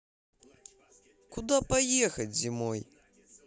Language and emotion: Russian, positive